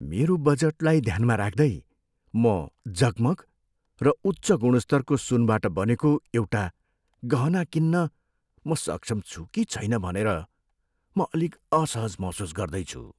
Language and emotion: Nepali, fearful